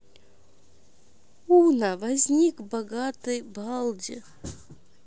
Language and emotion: Russian, neutral